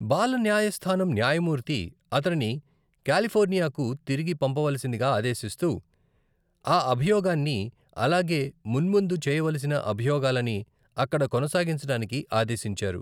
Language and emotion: Telugu, neutral